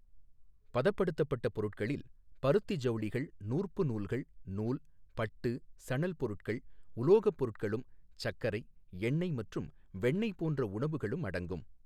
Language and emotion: Tamil, neutral